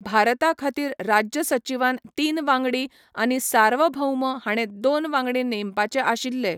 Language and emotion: Goan Konkani, neutral